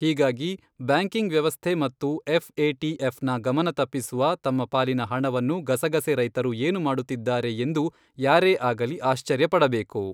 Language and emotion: Kannada, neutral